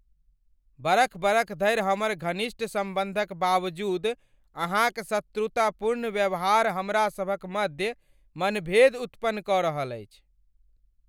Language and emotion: Maithili, angry